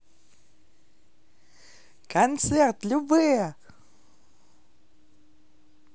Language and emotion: Russian, positive